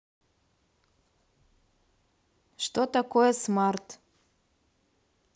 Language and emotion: Russian, neutral